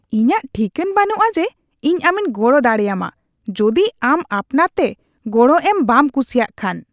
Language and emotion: Santali, disgusted